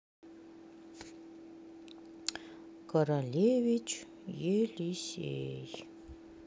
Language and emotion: Russian, neutral